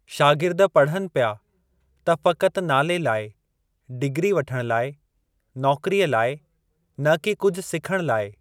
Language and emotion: Sindhi, neutral